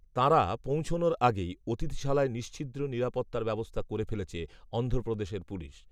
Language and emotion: Bengali, neutral